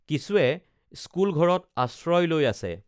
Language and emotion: Assamese, neutral